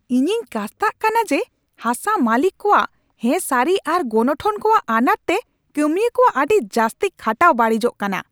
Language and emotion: Santali, angry